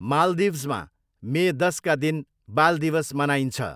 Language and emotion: Nepali, neutral